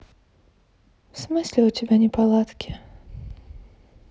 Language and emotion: Russian, sad